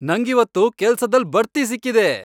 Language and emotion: Kannada, happy